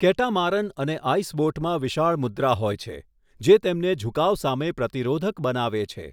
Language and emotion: Gujarati, neutral